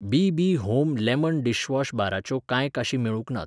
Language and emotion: Goan Konkani, neutral